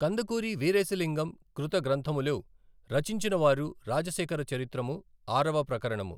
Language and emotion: Telugu, neutral